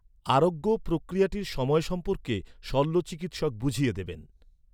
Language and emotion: Bengali, neutral